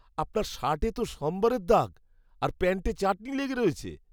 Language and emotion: Bengali, disgusted